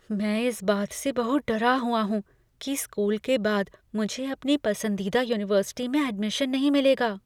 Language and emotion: Hindi, fearful